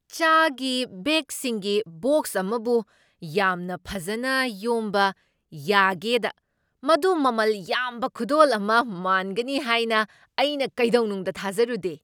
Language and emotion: Manipuri, surprised